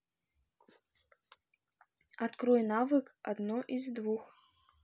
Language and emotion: Russian, neutral